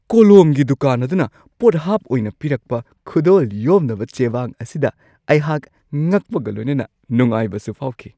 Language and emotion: Manipuri, surprised